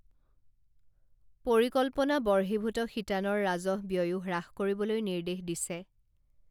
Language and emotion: Assamese, neutral